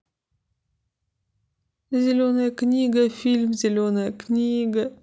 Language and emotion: Russian, sad